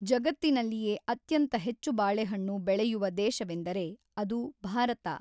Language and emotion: Kannada, neutral